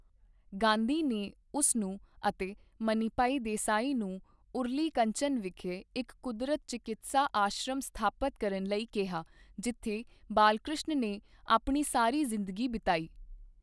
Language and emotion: Punjabi, neutral